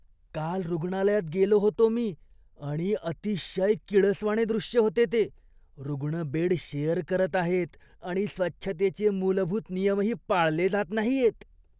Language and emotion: Marathi, disgusted